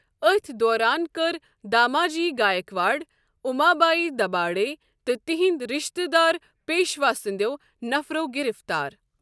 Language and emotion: Kashmiri, neutral